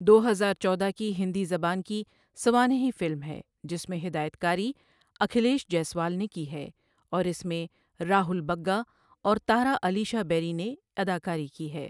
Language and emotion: Urdu, neutral